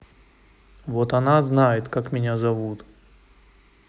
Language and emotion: Russian, angry